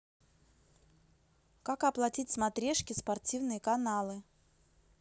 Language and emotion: Russian, neutral